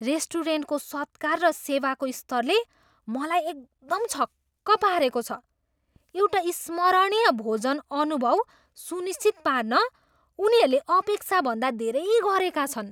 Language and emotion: Nepali, surprised